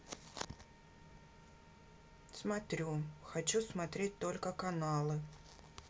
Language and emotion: Russian, neutral